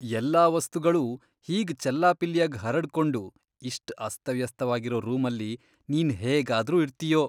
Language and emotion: Kannada, disgusted